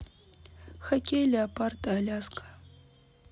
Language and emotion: Russian, neutral